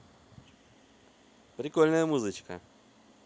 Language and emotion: Russian, positive